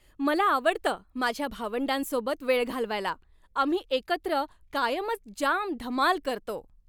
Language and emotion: Marathi, happy